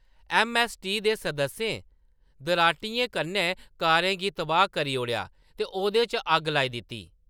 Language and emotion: Dogri, neutral